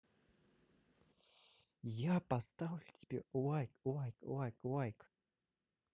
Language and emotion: Russian, positive